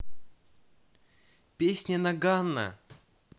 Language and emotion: Russian, neutral